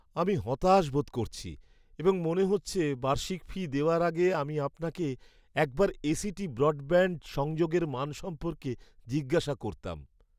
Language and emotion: Bengali, sad